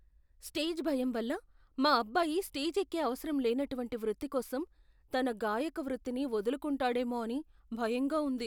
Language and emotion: Telugu, fearful